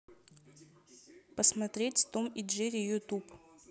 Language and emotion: Russian, neutral